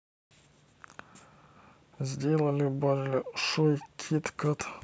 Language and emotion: Russian, neutral